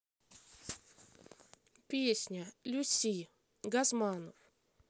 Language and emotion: Russian, neutral